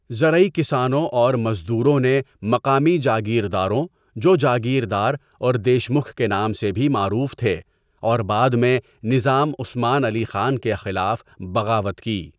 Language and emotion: Urdu, neutral